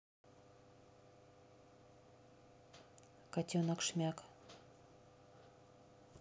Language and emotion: Russian, neutral